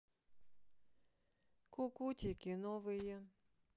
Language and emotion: Russian, sad